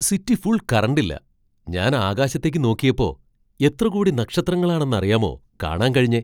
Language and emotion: Malayalam, surprised